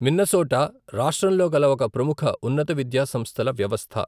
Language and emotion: Telugu, neutral